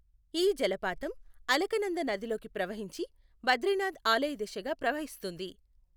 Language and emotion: Telugu, neutral